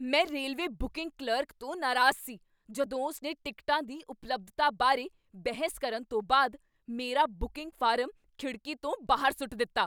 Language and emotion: Punjabi, angry